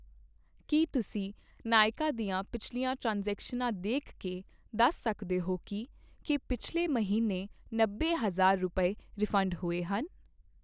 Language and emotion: Punjabi, neutral